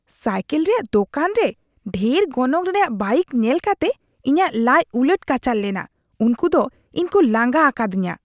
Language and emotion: Santali, disgusted